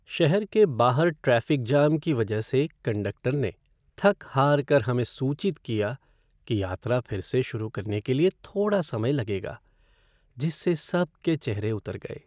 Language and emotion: Hindi, sad